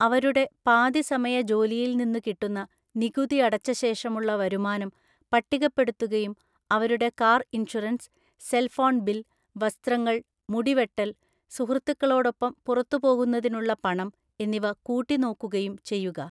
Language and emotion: Malayalam, neutral